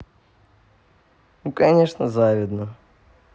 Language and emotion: Russian, positive